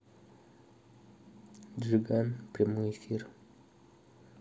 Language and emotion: Russian, neutral